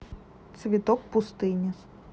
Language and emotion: Russian, neutral